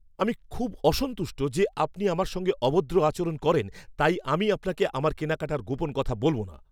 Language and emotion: Bengali, angry